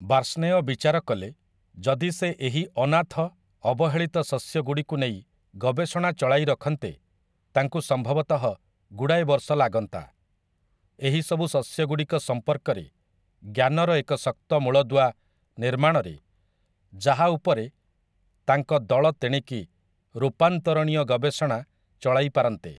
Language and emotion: Odia, neutral